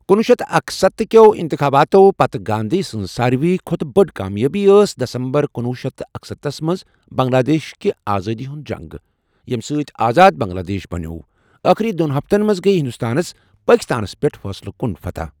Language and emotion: Kashmiri, neutral